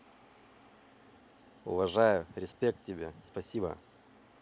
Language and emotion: Russian, positive